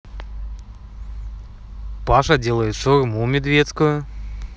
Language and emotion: Russian, positive